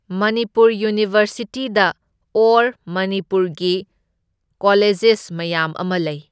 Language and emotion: Manipuri, neutral